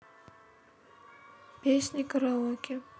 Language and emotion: Russian, neutral